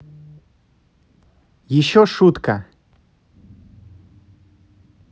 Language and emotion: Russian, neutral